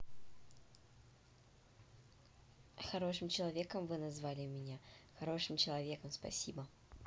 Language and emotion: Russian, positive